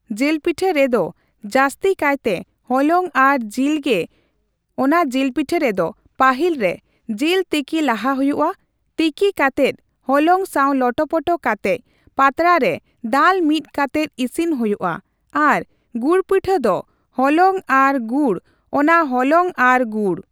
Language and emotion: Santali, neutral